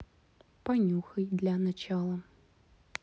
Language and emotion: Russian, neutral